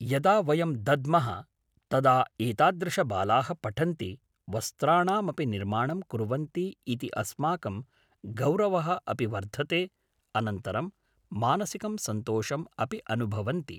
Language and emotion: Sanskrit, neutral